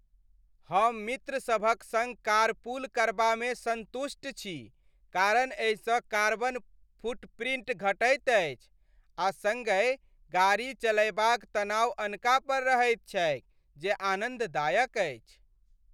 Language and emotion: Maithili, happy